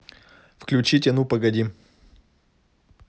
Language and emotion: Russian, neutral